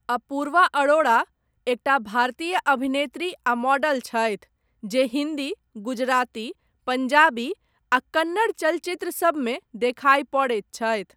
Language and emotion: Maithili, neutral